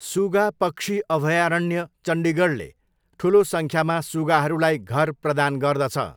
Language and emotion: Nepali, neutral